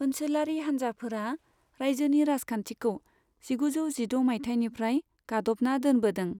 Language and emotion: Bodo, neutral